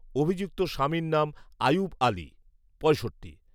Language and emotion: Bengali, neutral